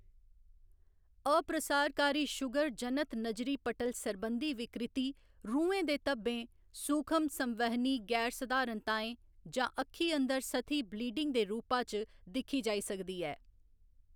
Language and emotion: Dogri, neutral